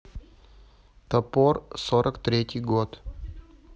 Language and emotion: Russian, neutral